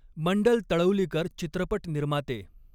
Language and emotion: Marathi, neutral